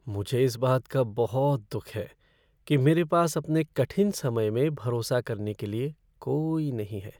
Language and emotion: Hindi, sad